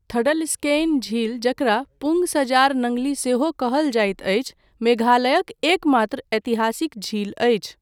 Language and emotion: Maithili, neutral